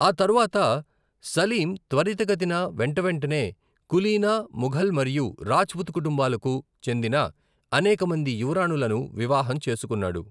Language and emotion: Telugu, neutral